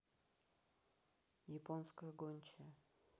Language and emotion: Russian, neutral